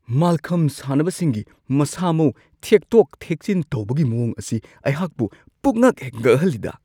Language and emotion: Manipuri, surprised